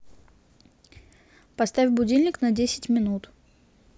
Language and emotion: Russian, neutral